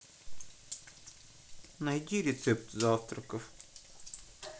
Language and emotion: Russian, sad